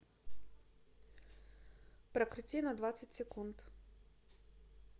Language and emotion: Russian, neutral